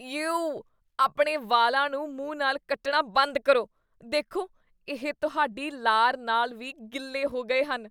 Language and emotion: Punjabi, disgusted